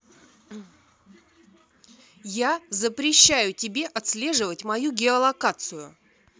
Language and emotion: Russian, angry